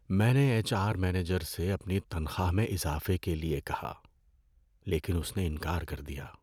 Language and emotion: Urdu, sad